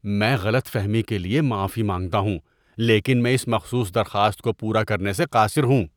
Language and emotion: Urdu, disgusted